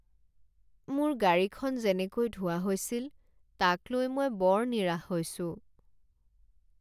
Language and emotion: Assamese, sad